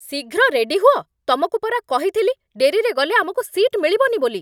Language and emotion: Odia, angry